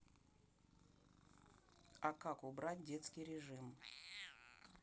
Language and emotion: Russian, neutral